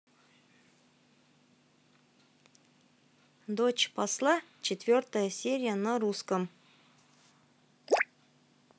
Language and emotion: Russian, neutral